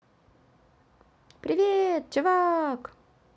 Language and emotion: Russian, positive